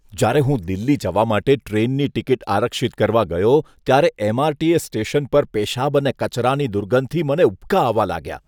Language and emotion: Gujarati, disgusted